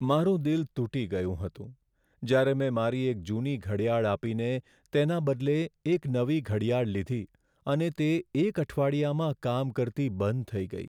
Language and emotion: Gujarati, sad